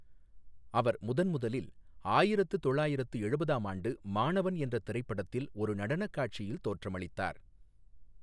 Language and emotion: Tamil, neutral